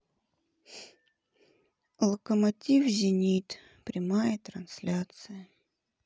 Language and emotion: Russian, sad